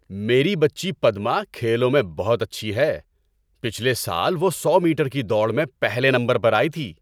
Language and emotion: Urdu, happy